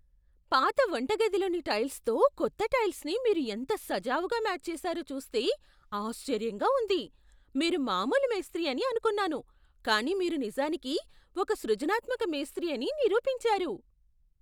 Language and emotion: Telugu, surprised